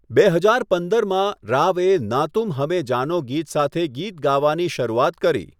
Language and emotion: Gujarati, neutral